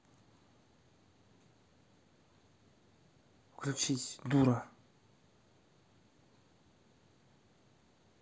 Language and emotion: Russian, angry